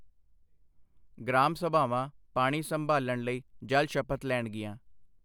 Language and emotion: Punjabi, neutral